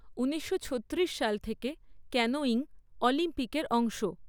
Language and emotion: Bengali, neutral